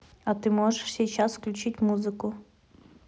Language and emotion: Russian, neutral